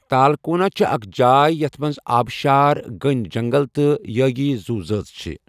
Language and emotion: Kashmiri, neutral